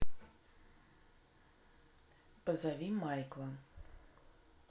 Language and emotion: Russian, neutral